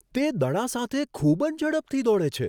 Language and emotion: Gujarati, surprised